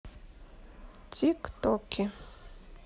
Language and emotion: Russian, neutral